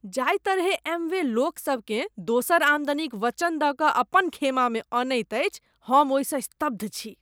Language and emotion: Maithili, disgusted